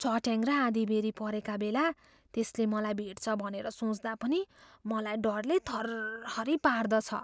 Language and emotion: Nepali, fearful